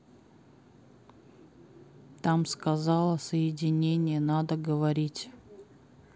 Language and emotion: Russian, sad